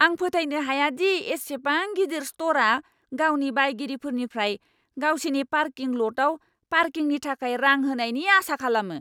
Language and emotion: Bodo, angry